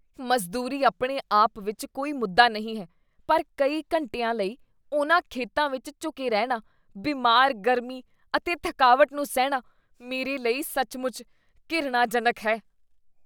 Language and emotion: Punjabi, disgusted